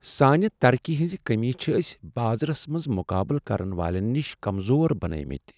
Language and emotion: Kashmiri, sad